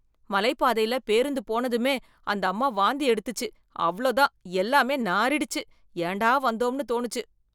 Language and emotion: Tamil, disgusted